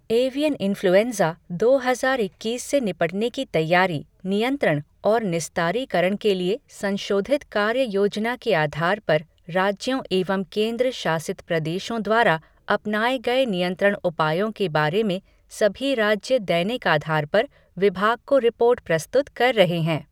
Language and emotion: Hindi, neutral